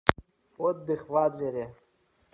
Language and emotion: Russian, neutral